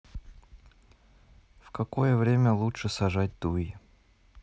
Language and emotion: Russian, neutral